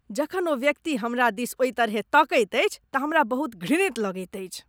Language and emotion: Maithili, disgusted